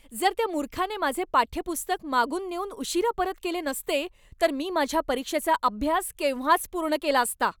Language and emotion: Marathi, angry